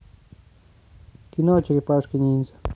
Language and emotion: Russian, neutral